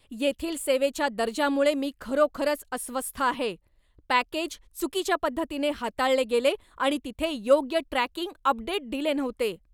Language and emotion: Marathi, angry